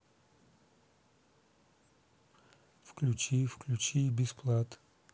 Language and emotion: Russian, neutral